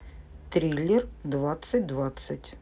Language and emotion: Russian, neutral